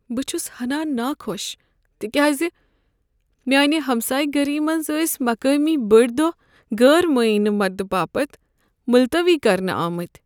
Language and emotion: Kashmiri, sad